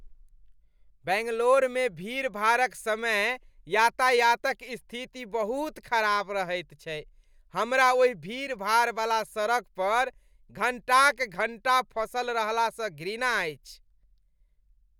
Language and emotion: Maithili, disgusted